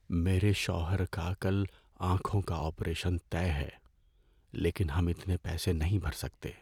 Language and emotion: Urdu, sad